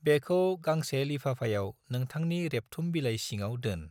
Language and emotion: Bodo, neutral